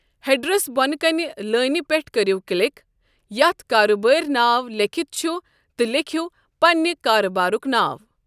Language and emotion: Kashmiri, neutral